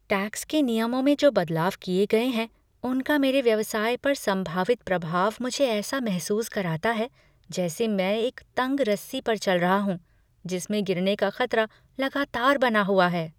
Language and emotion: Hindi, fearful